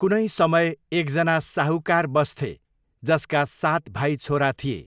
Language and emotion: Nepali, neutral